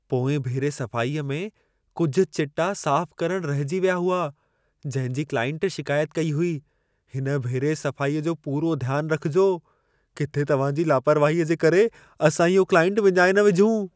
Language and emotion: Sindhi, fearful